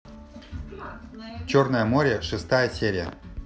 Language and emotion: Russian, neutral